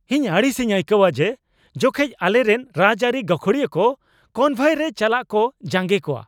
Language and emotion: Santali, angry